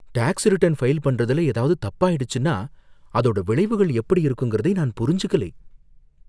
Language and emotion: Tamil, fearful